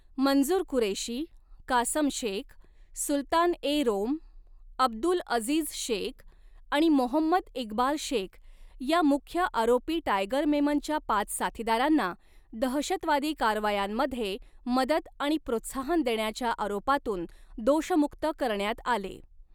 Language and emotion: Marathi, neutral